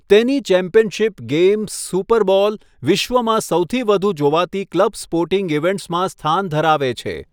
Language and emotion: Gujarati, neutral